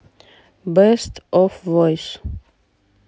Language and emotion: Russian, neutral